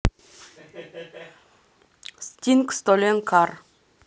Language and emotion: Russian, neutral